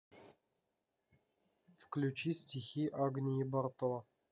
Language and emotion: Russian, neutral